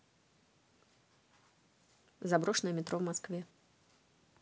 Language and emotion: Russian, neutral